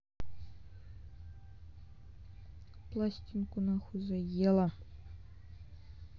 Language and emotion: Russian, angry